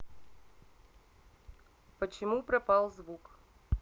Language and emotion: Russian, neutral